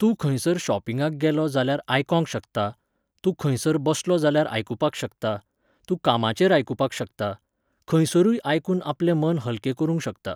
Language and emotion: Goan Konkani, neutral